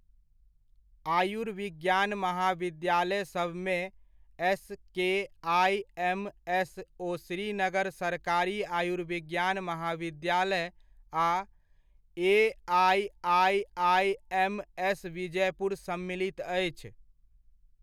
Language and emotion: Maithili, neutral